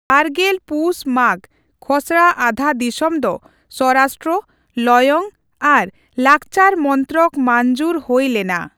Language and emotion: Santali, neutral